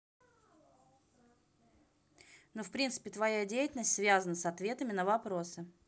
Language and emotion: Russian, neutral